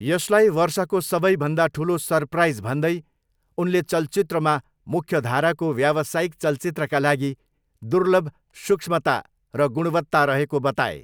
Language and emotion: Nepali, neutral